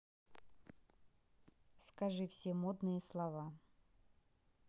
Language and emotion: Russian, neutral